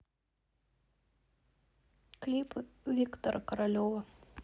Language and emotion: Russian, sad